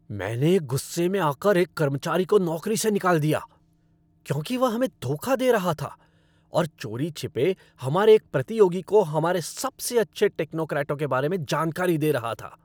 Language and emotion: Hindi, angry